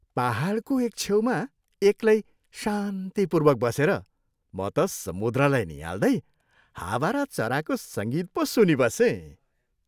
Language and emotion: Nepali, happy